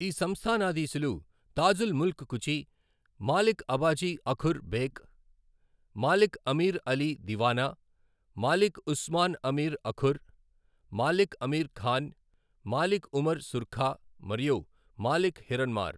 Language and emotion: Telugu, neutral